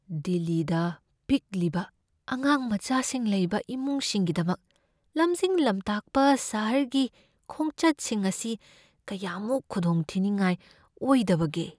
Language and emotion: Manipuri, fearful